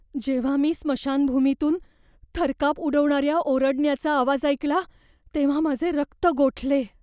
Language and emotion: Marathi, fearful